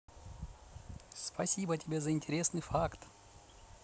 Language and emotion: Russian, positive